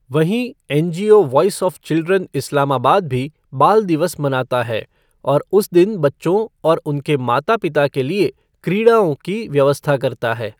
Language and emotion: Hindi, neutral